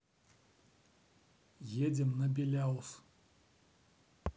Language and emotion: Russian, neutral